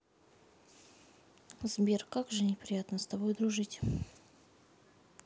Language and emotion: Russian, sad